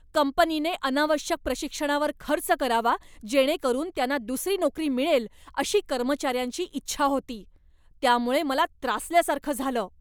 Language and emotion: Marathi, angry